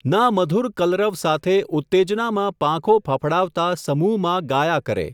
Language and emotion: Gujarati, neutral